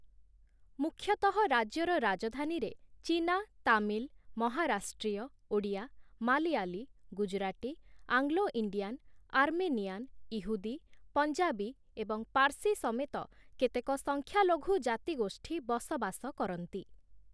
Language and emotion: Odia, neutral